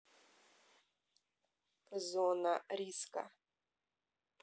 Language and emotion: Russian, neutral